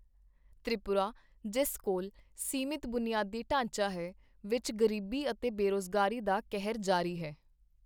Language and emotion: Punjabi, neutral